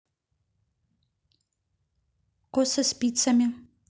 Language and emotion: Russian, neutral